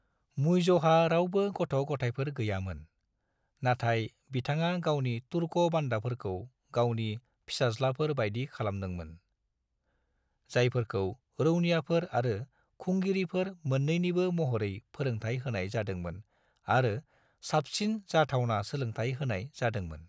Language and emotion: Bodo, neutral